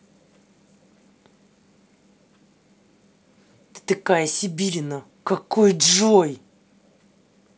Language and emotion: Russian, angry